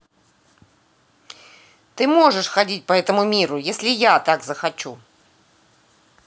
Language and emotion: Russian, angry